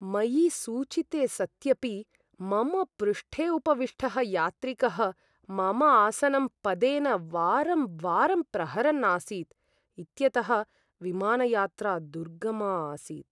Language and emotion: Sanskrit, sad